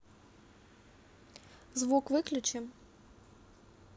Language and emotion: Russian, neutral